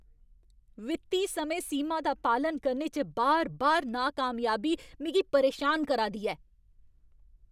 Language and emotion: Dogri, angry